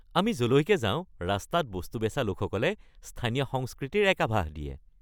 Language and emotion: Assamese, happy